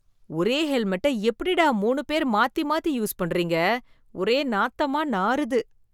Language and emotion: Tamil, disgusted